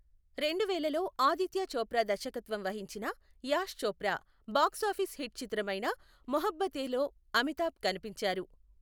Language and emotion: Telugu, neutral